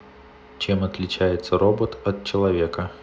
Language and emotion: Russian, neutral